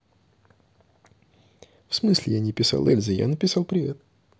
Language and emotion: Russian, neutral